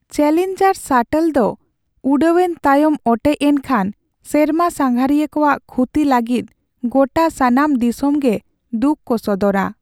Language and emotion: Santali, sad